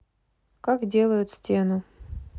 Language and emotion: Russian, neutral